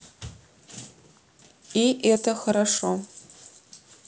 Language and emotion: Russian, neutral